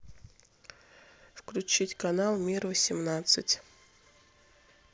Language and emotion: Russian, neutral